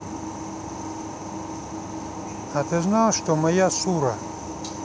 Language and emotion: Russian, neutral